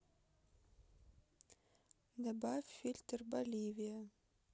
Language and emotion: Russian, neutral